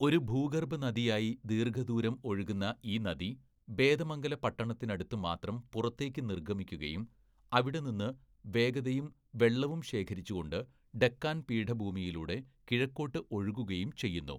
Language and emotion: Malayalam, neutral